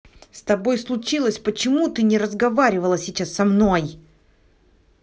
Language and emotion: Russian, angry